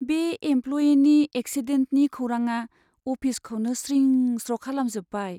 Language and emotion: Bodo, sad